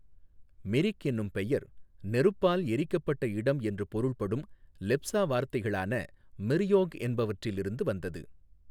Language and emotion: Tamil, neutral